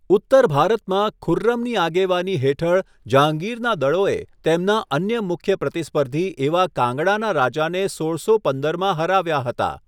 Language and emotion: Gujarati, neutral